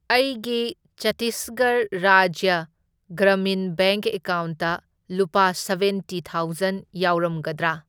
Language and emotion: Manipuri, neutral